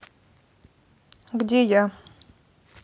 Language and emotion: Russian, neutral